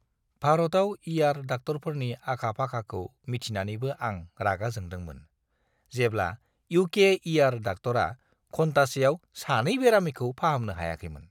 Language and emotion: Bodo, disgusted